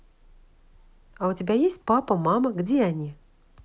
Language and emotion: Russian, positive